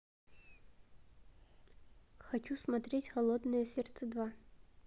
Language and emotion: Russian, neutral